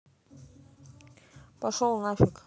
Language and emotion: Russian, neutral